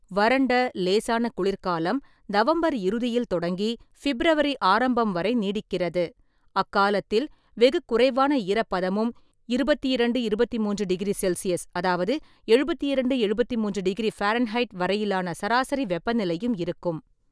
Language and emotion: Tamil, neutral